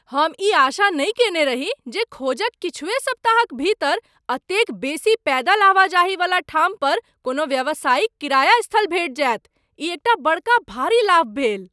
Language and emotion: Maithili, surprised